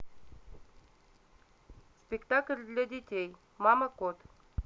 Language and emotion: Russian, neutral